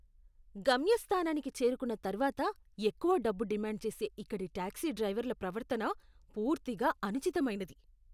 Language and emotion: Telugu, disgusted